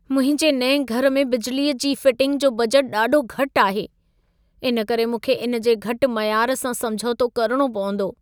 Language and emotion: Sindhi, sad